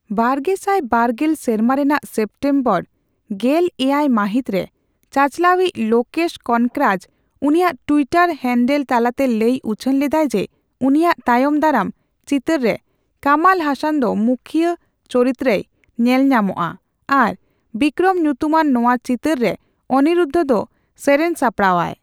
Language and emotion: Santali, neutral